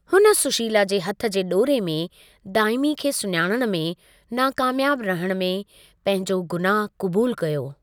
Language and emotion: Sindhi, neutral